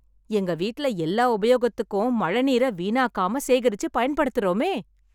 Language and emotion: Tamil, happy